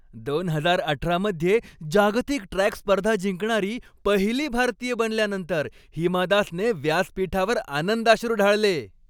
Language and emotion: Marathi, happy